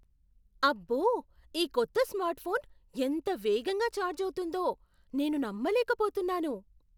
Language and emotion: Telugu, surprised